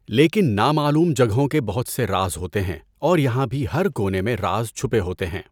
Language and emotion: Urdu, neutral